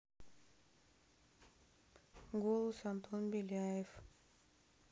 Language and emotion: Russian, neutral